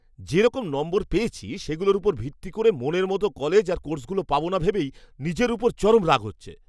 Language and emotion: Bengali, angry